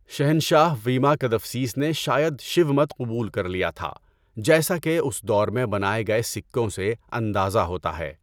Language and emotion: Urdu, neutral